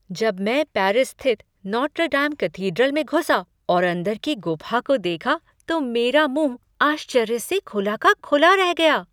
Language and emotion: Hindi, surprised